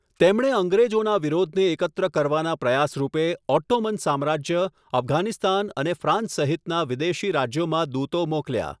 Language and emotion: Gujarati, neutral